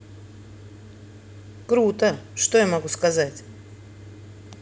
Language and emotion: Russian, neutral